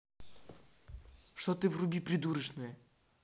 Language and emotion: Russian, angry